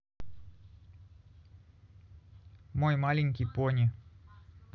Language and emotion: Russian, neutral